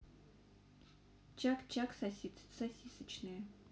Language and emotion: Russian, neutral